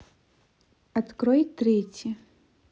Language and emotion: Russian, neutral